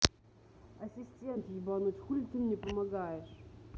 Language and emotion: Russian, angry